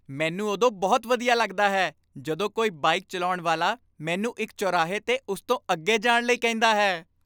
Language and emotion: Punjabi, happy